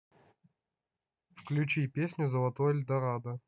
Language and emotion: Russian, neutral